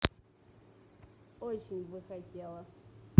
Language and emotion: Russian, neutral